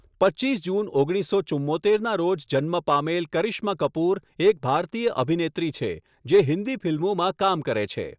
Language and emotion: Gujarati, neutral